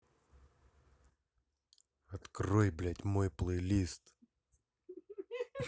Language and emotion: Russian, angry